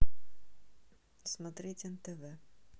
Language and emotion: Russian, neutral